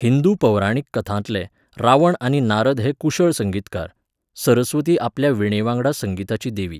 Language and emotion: Goan Konkani, neutral